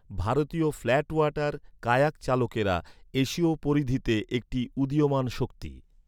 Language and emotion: Bengali, neutral